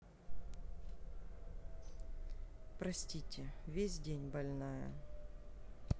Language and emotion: Russian, sad